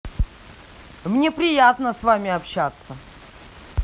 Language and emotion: Russian, angry